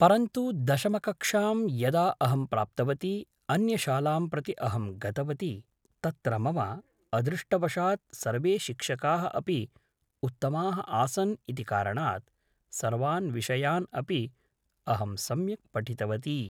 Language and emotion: Sanskrit, neutral